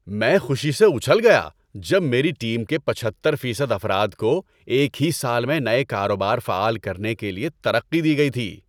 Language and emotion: Urdu, happy